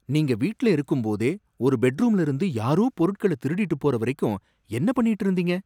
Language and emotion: Tamil, surprised